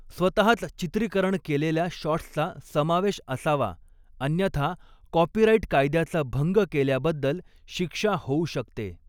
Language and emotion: Marathi, neutral